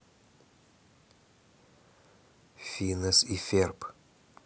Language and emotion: Russian, neutral